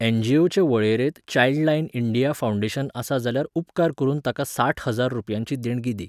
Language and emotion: Goan Konkani, neutral